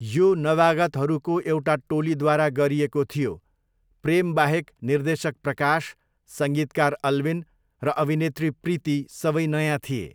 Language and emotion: Nepali, neutral